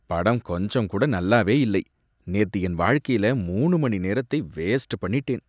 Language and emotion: Tamil, disgusted